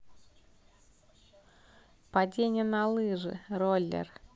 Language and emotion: Russian, positive